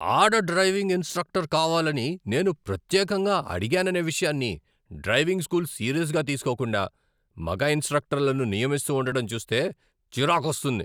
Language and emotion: Telugu, angry